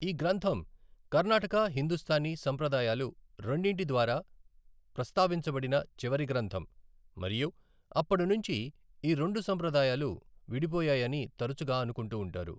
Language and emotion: Telugu, neutral